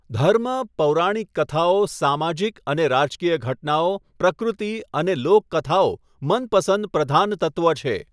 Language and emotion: Gujarati, neutral